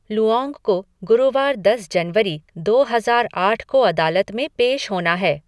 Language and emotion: Hindi, neutral